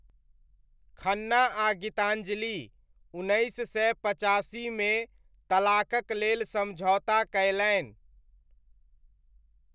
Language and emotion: Maithili, neutral